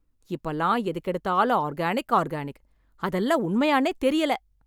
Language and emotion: Tamil, angry